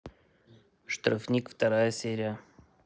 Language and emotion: Russian, neutral